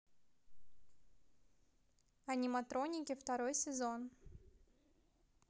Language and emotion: Russian, positive